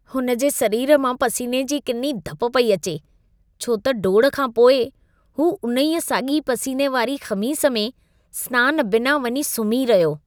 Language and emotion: Sindhi, disgusted